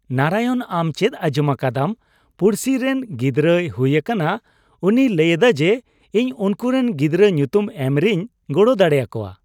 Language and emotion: Santali, happy